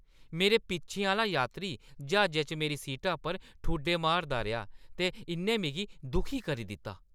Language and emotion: Dogri, angry